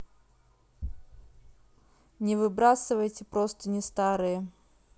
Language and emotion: Russian, neutral